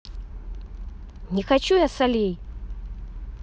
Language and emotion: Russian, angry